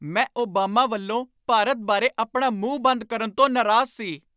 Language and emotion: Punjabi, angry